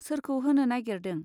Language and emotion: Bodo, neutral